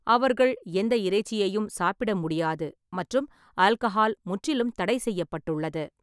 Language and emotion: Tamil, neutral